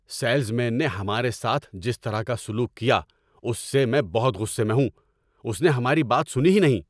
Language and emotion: Urdu, angry